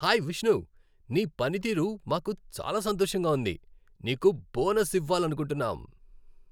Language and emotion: Telugu, happy